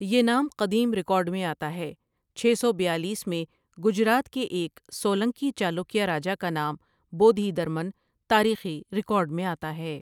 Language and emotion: Urdu, neutral